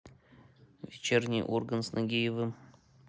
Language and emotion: Russian, neutral